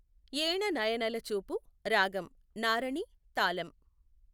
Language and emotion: Telugu, neutral